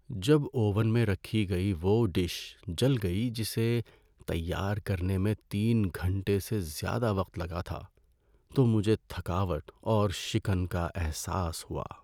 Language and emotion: Urdu, sad